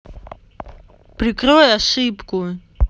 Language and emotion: Russian, angry